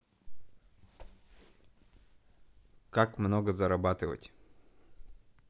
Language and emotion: Russian, neutral